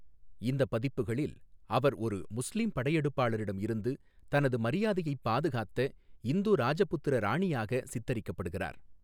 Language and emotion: Tamil, neutral